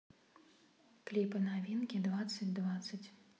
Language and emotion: Russian, neutral